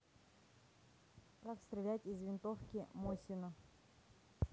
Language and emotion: Russian, neutral